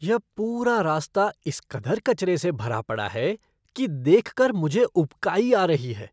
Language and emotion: Hindi, disgusted